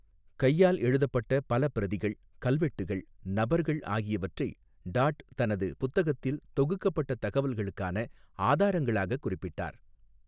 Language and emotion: Tamil, neutral